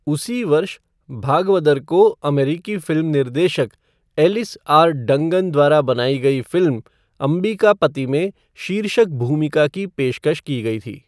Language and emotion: Hindi, neutral